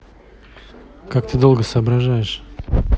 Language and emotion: Russian, neutral